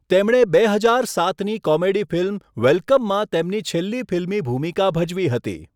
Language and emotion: Gujarati, neutral